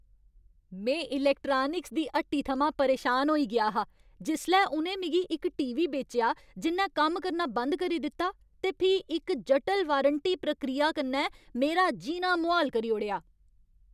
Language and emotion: Dogri, angry